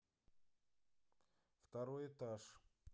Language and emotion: Russian, neutral